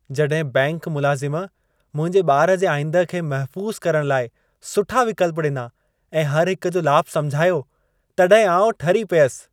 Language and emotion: Sindhi, happy